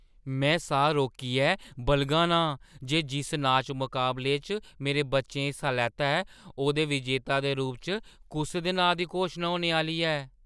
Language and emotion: Dogri, surprised